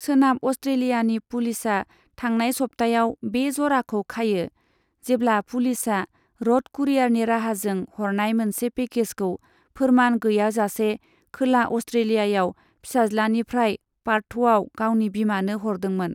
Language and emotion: Bodo, neutral